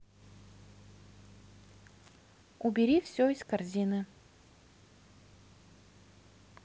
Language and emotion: Russian, neutral